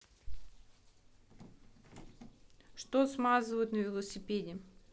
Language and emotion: Russian, neutral